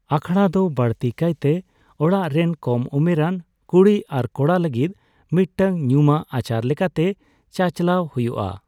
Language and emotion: Santali, neutral